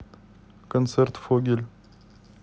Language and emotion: Russian, neutral